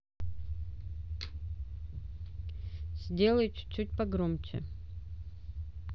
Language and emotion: Russian, neutral